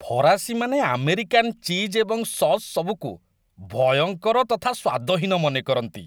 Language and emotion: Odia, disgusted